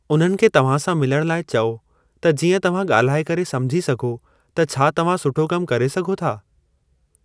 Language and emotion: Sindhi, neutral